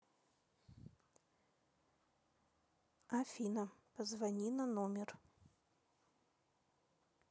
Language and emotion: Russian, neutral